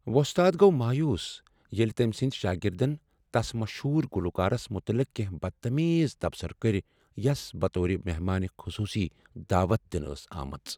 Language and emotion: Kashmiri, sad